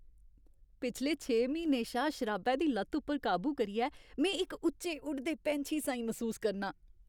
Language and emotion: Dogri, happy